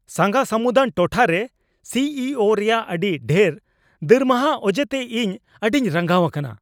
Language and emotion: Santali, angry